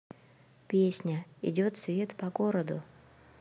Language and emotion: Russian, neutral